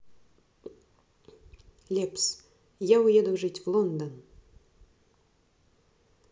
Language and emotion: Russian, neutral